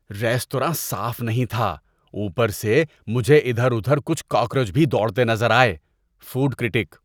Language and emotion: Urdu, disgusted